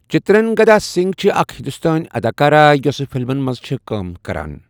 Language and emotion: Kashmiri, neutral